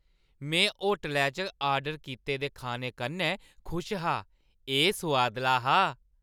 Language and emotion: Dogri, happy